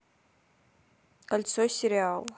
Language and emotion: Russian, neutral